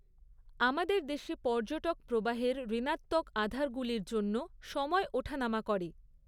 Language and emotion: Bengali, neutral